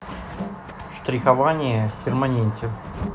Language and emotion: Russian, neutral